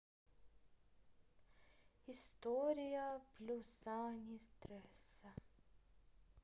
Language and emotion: Russian, neutral